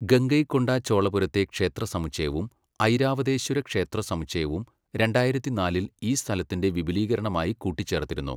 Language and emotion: Malayalam, neutral